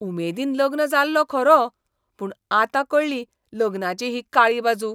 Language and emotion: Goan Konkani, disgusted